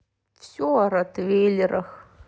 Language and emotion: Russian, sad